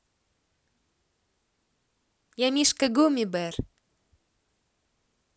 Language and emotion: Russian, positive